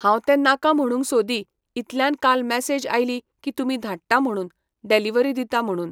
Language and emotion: Goan Konkani, neutral